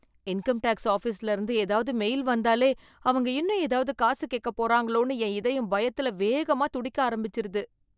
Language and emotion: Tamil, fearful